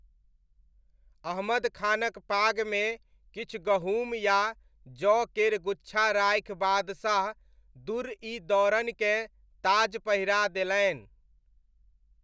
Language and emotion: Maithili, neutral